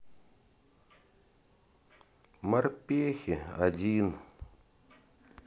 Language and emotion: Russian, sad